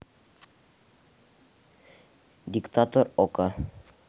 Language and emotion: Russian, neutral